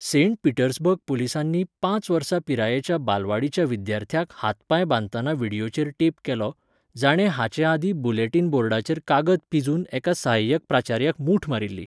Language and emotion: Goan Konkani, neutral